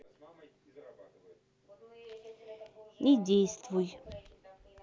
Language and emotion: Russian, neutral